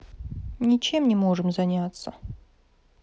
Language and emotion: Russian, sad